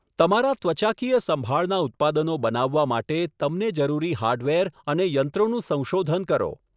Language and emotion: Gujarati, neutral